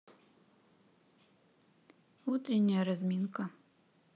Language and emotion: Russian, neutral